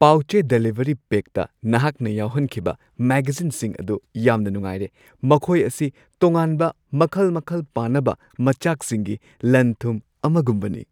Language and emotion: Manipuri, happy